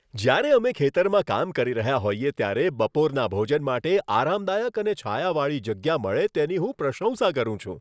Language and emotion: Gujarati, happy